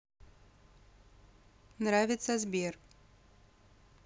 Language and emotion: Russian, neutral